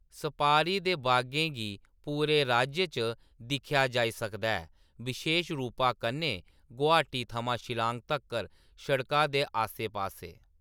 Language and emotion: Dogri, neutral